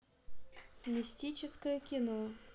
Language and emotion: Russian, neutral